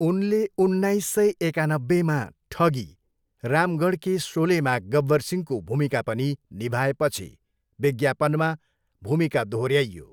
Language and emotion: Nepali, neutral